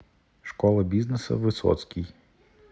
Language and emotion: Russian, neutral